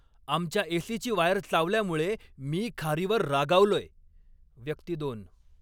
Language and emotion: Marathi, angry